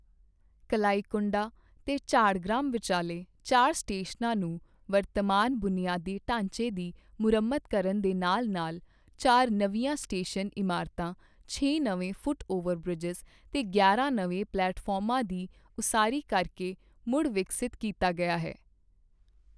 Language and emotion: Punjabi, neutral